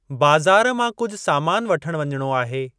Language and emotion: Sindhi, neutral